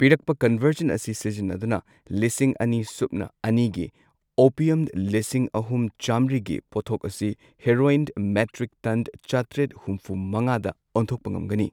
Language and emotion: Manipuri, neutral